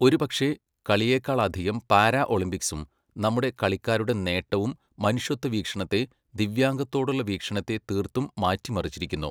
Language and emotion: Malayalam, neutral